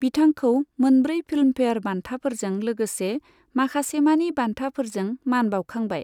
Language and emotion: Bodo, neutral